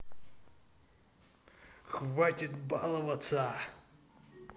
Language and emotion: Russian, angry